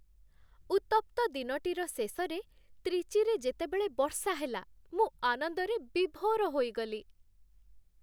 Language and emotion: Odia, happy